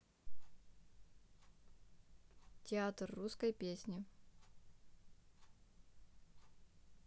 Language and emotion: Russian, neutral